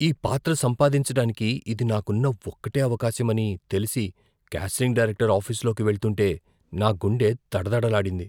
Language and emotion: Telugu, fearful